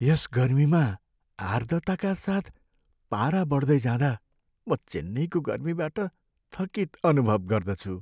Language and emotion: Nepali, sad